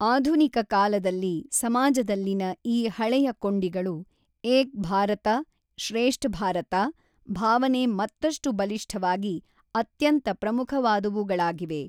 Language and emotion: Kannada, neutral